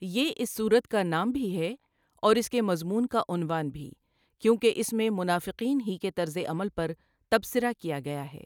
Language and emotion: Urdu, neutral